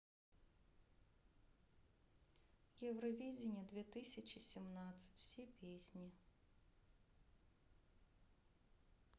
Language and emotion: Russian, sad